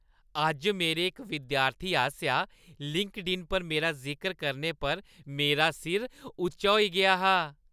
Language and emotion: Dogri, happy